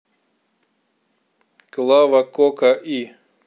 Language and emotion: Russian, neutral